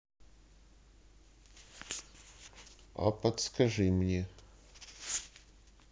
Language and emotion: Russian, neutral